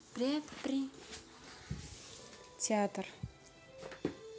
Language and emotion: Russian, neutral